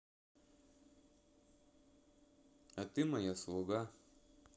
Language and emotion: Russian, neutral